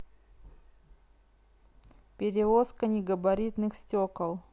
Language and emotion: Russian, neutral